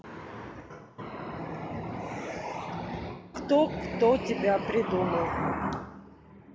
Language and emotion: Russian, neutral